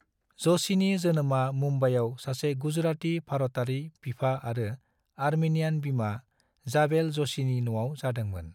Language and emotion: Bodo, neutral